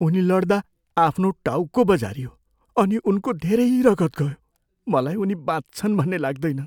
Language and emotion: Nepali, fearful